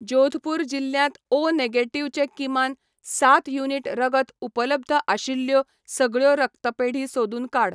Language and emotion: Goan Konkani, neutral